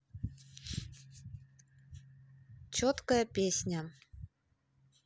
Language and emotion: Russian, neutral